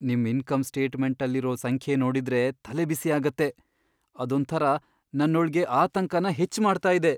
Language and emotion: Kannada, fearful